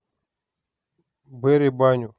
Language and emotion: Russian, neutral